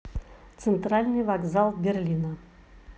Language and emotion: Russian, neutral